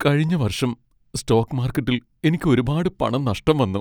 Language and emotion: Malayalam, sad